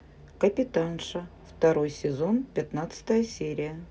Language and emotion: Russian, neutral